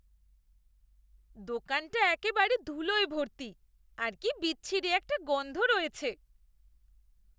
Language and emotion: Bengali, disgusted